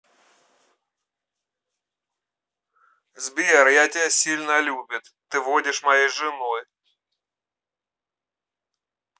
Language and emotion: Russian, positive